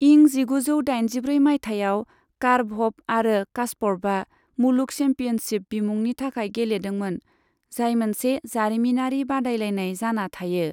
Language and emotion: Bodo, neutral